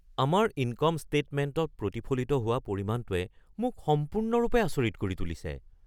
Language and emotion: Assamese, surprised